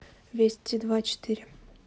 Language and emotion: Russian, neutral